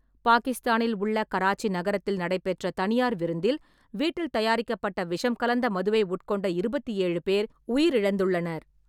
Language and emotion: Tamil, neutral